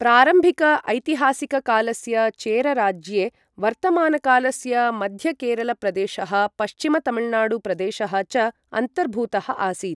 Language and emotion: Sanskrit, neutral